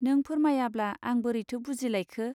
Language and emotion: Bodo, neutral